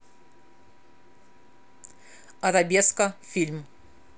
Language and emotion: Russian, angry